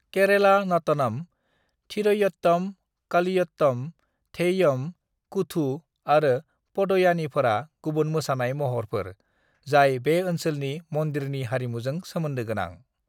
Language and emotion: Bodo, neutral